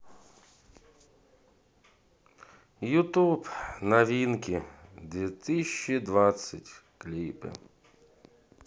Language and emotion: Russian, sad